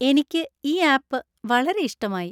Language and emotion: Malayalam, happy